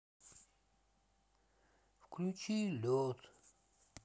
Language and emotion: Russian, sad